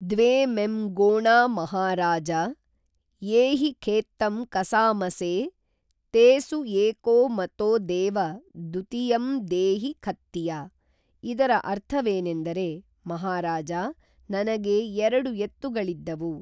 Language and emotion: Kannada, neutral